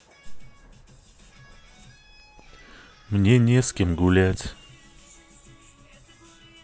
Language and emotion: Russian, sad